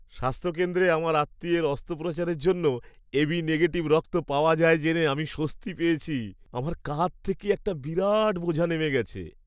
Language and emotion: Bengali, happy